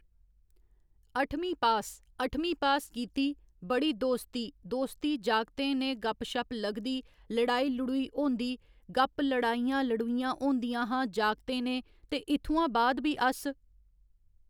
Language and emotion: Dogri, neutral